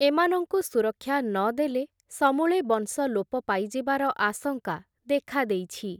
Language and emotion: Odia, neutral